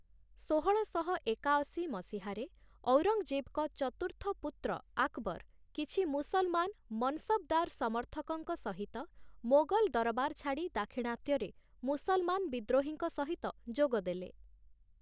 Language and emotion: Odia, neutral